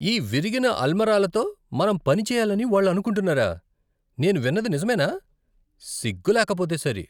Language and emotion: Telugu, disgusted